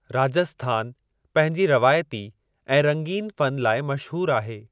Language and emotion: Sindhi, neutral